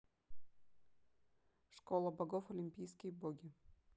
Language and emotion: Russian, neutral